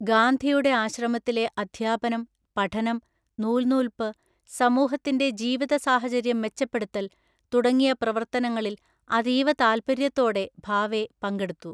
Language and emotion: Malayalam, neutral